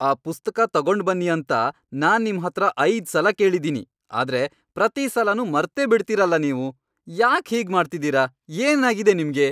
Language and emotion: Kannada, angry